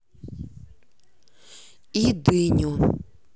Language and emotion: Russian, neutral